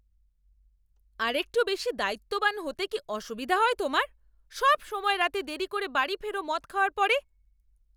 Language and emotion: Bengali, angry